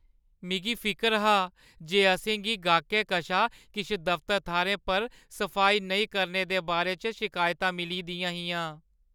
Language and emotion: Dogri, sad